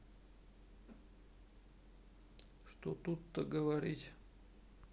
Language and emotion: Russian, sad